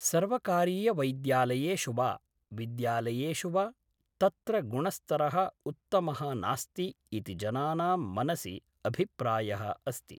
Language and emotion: Sanskrit, neutral